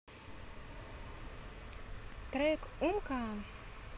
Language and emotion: Russian, positive